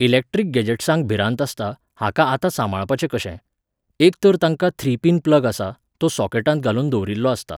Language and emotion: Goan Konkani, neutral